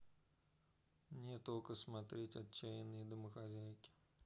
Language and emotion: Russian, neutral